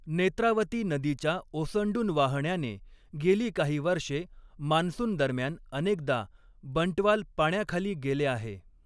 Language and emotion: Marathi, neutral